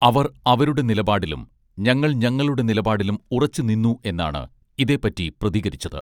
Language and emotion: Malayalam, neutral